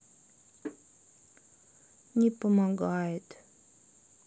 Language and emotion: Russian, sad